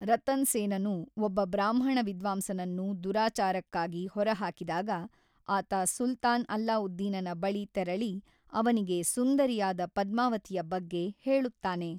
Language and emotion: Kannada, neutral